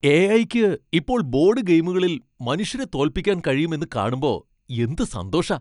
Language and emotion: Malayalam, happy